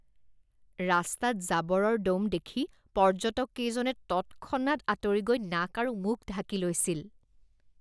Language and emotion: Assamese, disgusted